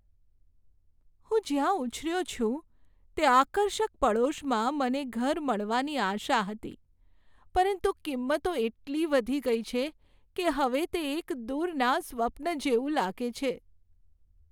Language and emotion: Gujarati, sad